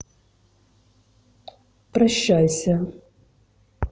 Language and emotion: Russian, neutral